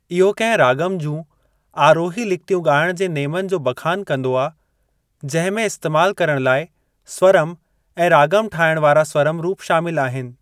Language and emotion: Sindhi, neutral